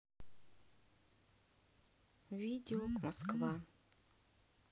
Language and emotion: Russian, sad